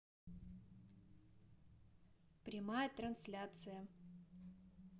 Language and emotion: Russian, neutral